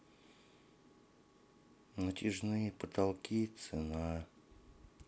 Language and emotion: Russian, sad